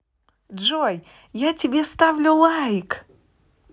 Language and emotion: Russian, positive